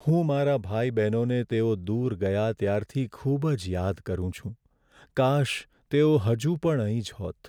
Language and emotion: Gujarati, sad